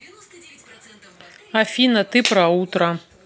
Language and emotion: Russian, neutral